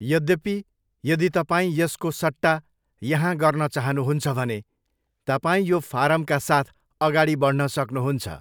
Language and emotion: Nepali, neutral